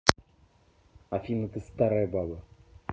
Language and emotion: Russian, angry